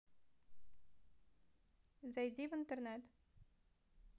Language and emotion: Russian, neutral